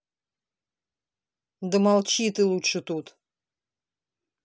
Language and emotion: Russian, angry